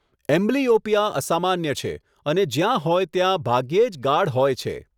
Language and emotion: Gujarati, neutral